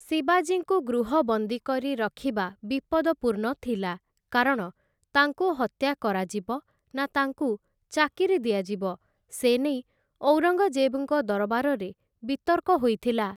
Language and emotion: Odia, neutral